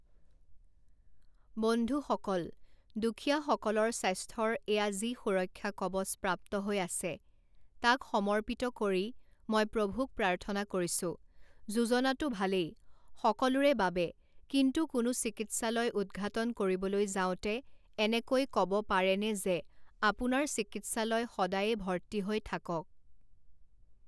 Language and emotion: Assamese, neutral